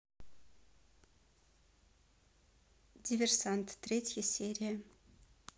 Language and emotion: Russian, neutral